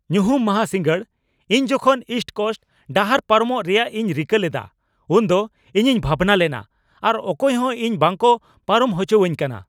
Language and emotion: Santali, angry